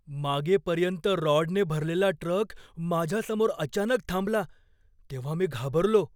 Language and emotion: Marathi, fearful